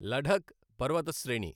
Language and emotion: Telugu, neutral